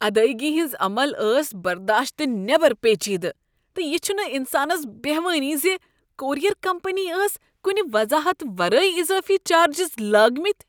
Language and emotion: Kashmiri, disgusted